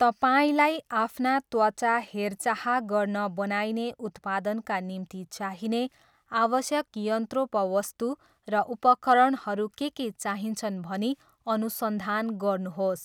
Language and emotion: Nepali, neutral